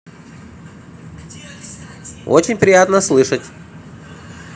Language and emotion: Russian, positive